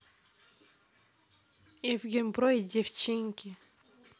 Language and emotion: Russian, neutral